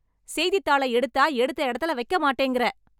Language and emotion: Tamil, angry